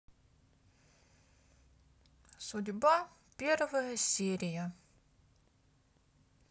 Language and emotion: Russian, neutral